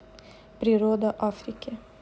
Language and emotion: Russian, neutral